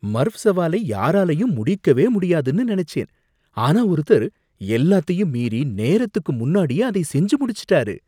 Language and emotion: Tamil, surprised